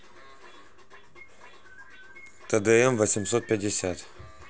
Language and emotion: Russian, neutral